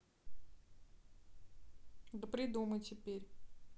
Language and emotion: Russian, neutral